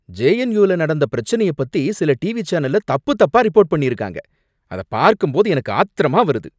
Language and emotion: Tamil, angry